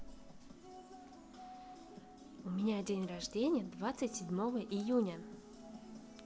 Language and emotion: Russian, positive